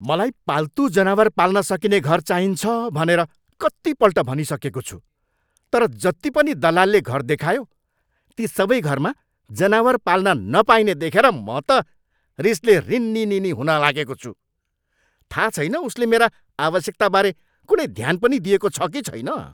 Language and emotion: Nepali, angry